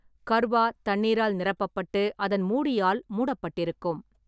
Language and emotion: Tamil, neutral